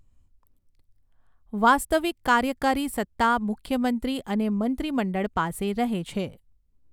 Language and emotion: Gujarati, neutral